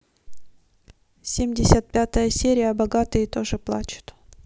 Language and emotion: Russian, neutral